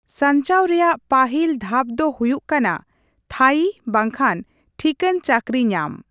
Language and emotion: Santali, neutral